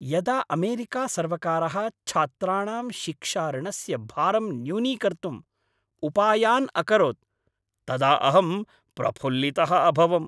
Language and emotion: Sanskrit, happy